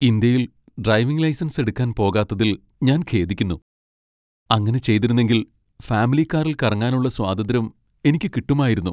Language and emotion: Malayalam, sad